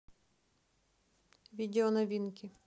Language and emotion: Russian, neutral